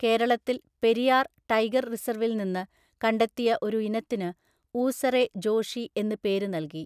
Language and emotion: Malayalam, neutral